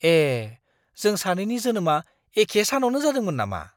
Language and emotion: Bodo, surprised